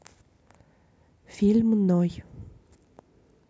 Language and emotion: Russian, neutral